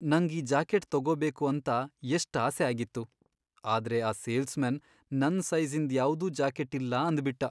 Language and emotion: Kannada, sad